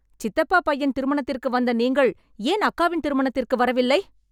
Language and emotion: Tamil, angry